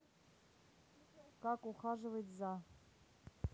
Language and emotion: Russian, neutral